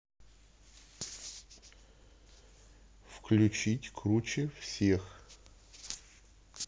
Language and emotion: Russian, neutral